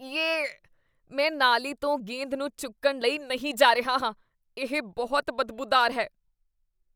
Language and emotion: Punjabi, disgusted